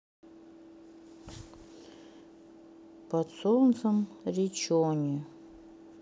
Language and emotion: Russian, sad